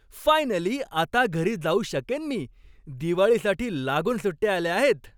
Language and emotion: Marathi, happy